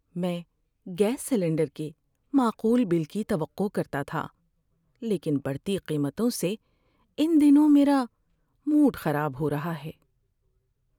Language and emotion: Urdu, sad